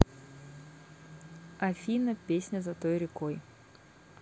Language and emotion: Russian, neutral